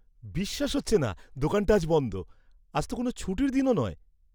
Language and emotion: Bengali, surprised